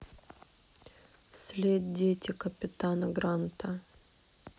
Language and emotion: Russian, sad